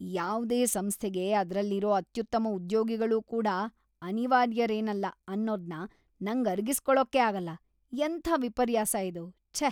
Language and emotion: Kannada, disgusted